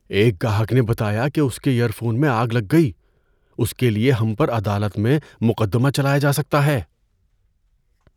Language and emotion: Urdu, fearful